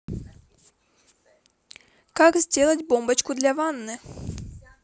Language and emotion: Russian, positive